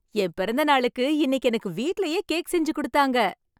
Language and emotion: Tamil, happy